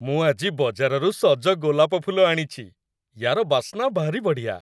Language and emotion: Odia, happy